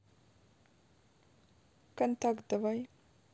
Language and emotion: Russian, neutral